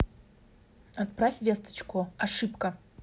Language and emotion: Russian, neutral